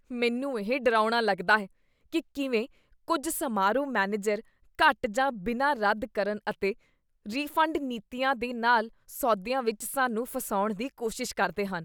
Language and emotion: Punjabi, disgusted